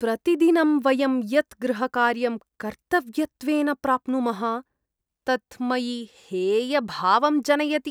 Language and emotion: Sanskrit, disgusted